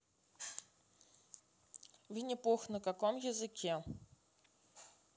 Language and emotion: Russian, neutral